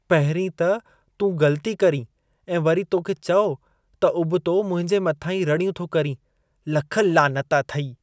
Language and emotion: Sindhi, disgusted